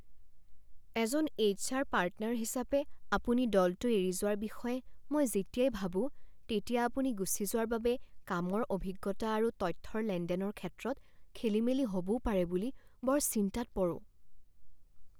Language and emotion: Assamese, fearful